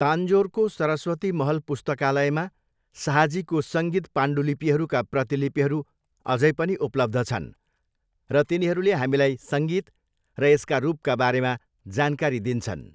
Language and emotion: Nepali, neutral